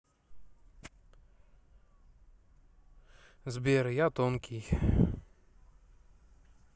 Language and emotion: Russian, sad